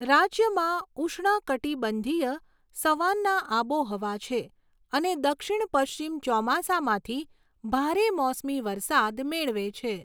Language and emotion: Gujarati, neutral